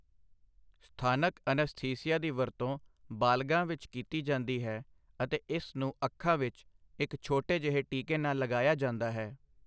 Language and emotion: Punjabi, neutral